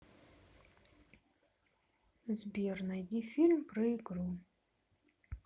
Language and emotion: Russian, neutral